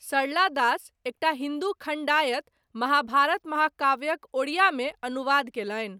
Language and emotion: Maithili, neutral